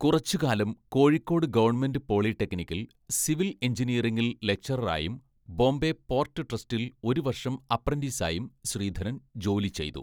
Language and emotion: Malayalam, neutral